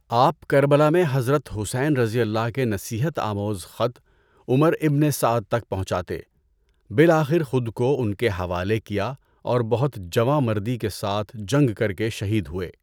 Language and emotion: Urdu, neutral